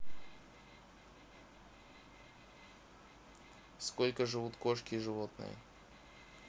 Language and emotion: Russian, neutral